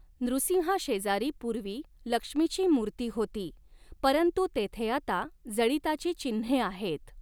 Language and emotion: Marathi, neutral